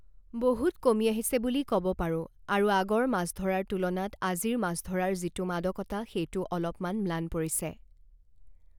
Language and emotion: Assamese, neutral